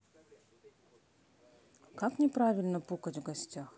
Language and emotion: Russian, neutral